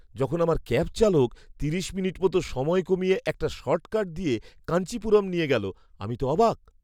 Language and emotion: Bengali, surprised